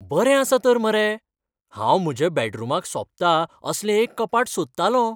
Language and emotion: Goan Konkani, happy